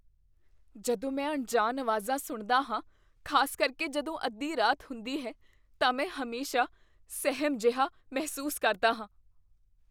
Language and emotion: Punjabi, fearful